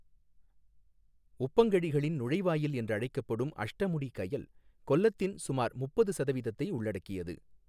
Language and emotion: Tamil, neutral